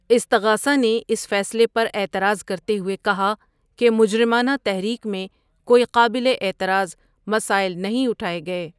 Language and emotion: Urdu, neutral